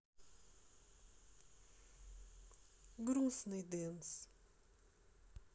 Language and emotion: Russian, sad